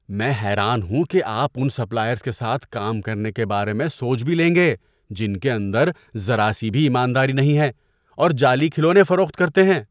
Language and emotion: Urdu, disgusted